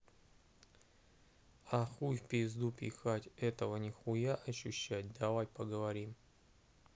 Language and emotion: Russian, neutral